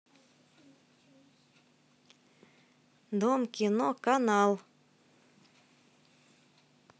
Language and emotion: Russian, neutral